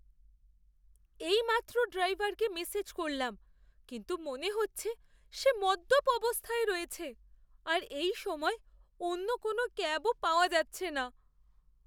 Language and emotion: Bengali, fearful